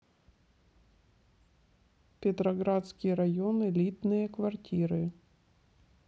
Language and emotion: Russian, neutral